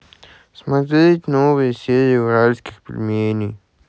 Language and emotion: Russian, sad